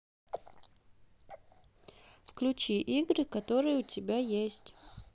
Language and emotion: Russian, neutral